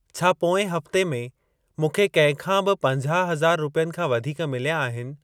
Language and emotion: Sindhi, neutral